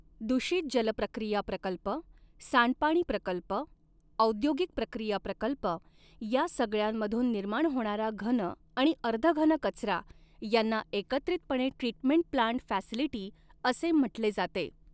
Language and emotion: Marathi, neutral